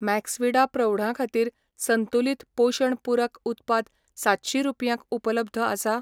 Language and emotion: Goan Konkani, neutral